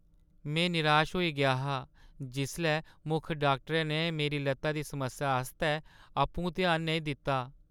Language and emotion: Dogri, sad